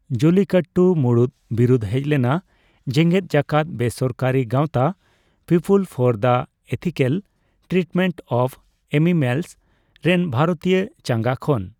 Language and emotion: Santali, neutral